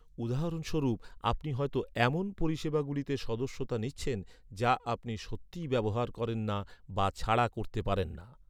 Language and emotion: Bengali, neutral